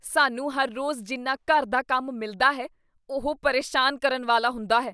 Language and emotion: Punjabi, disgusted